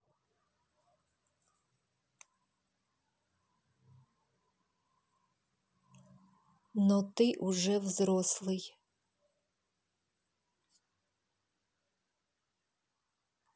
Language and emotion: Russian, neutral